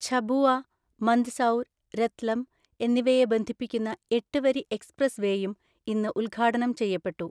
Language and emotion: Malayalam, neutral